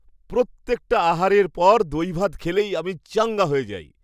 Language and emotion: Bengali, happy